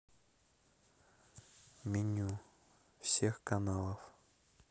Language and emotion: Russian, neutral